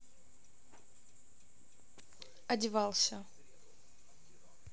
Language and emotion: Russian, neutral